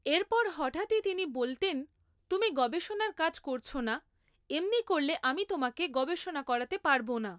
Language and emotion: Bengali, neutral